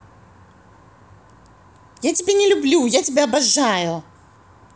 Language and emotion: Russian, positive